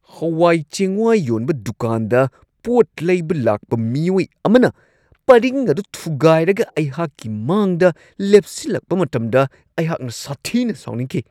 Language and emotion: Manipuri, angry